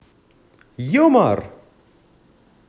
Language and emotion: Russian, positive